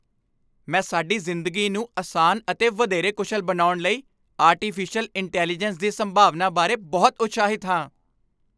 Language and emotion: Punjabi, happy